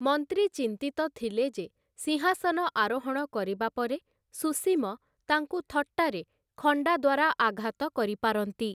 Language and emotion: Odia, neutral